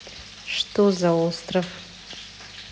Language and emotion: Russian, neutral